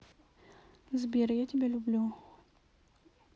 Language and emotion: Russian, neutral